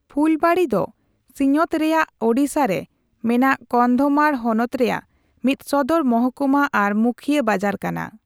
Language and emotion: Santali, neutral